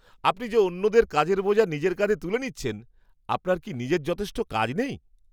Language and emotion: Bengali, surprised